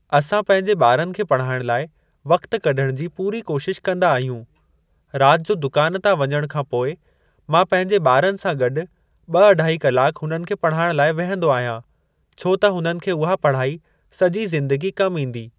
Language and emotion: Sindhi, neutral